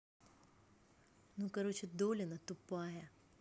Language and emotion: Russian, angry